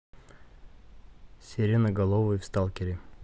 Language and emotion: Russian, neutral